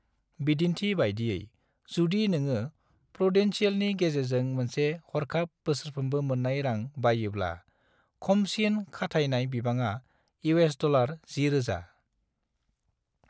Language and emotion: Bodo, neutral